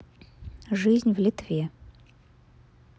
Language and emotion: Russian, neutral